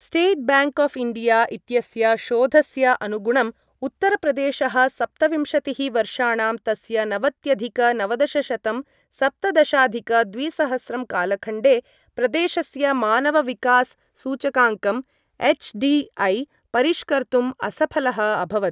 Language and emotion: Sanskrit, neutral